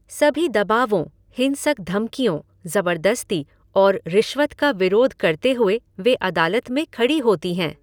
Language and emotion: Hindi, neutral